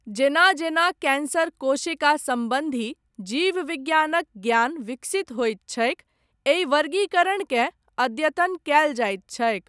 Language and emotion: Maithili, neutral